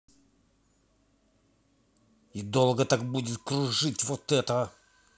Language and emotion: Russian, angry